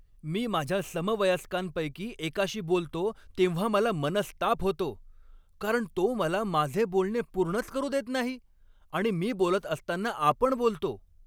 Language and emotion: Marathi, angry